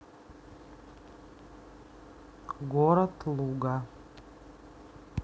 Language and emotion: Russian, neutral